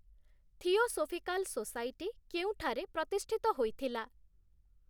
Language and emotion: Odia, neutral